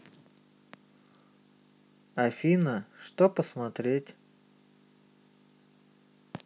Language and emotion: Russian, neutral